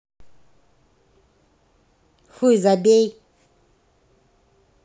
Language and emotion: Russian, angry